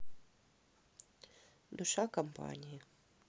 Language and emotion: Russian, neutral